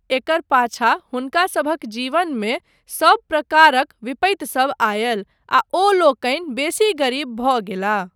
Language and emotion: Maithili, neutral